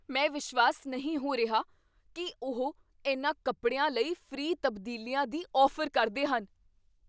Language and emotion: Punjabi, surprised